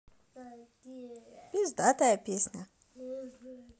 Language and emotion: Russian, positive